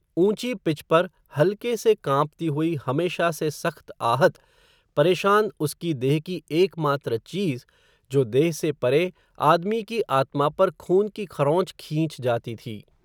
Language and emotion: Hindi, neutral